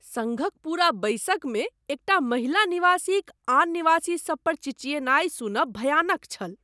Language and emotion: Maithili, disgusted